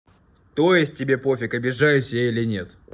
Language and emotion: Russian, angry